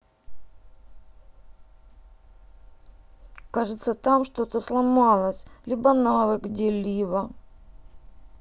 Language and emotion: Russian, sad